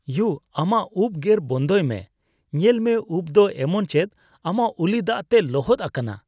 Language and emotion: Santali, disgusted